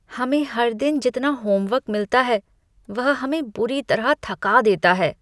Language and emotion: Hindi, disgusted